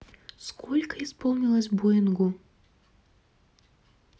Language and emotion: Russian, neutral